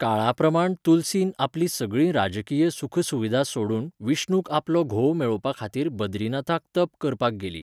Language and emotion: Goan Konkani, neutral